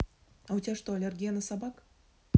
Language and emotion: Russian, neutral